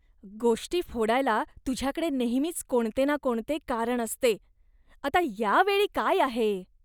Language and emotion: Marathi, disgusted